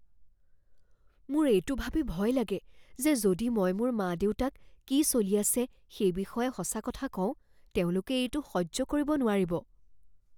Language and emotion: Assamese, fearful